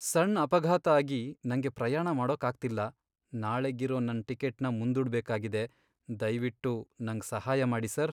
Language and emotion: Kannada, sad